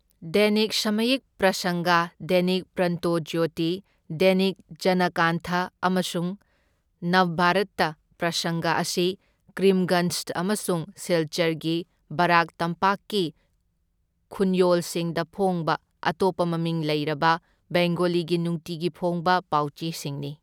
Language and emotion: Manipuri, neutral